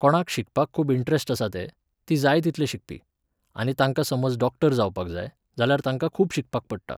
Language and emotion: Goan Konkani, neutral